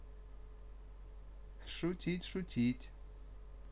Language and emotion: Russian, positive